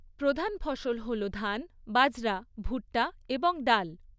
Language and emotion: Bengali, neutral